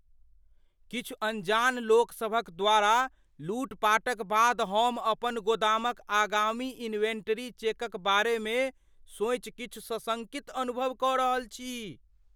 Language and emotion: Maithili, fearful